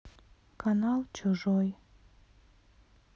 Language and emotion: Russian, sad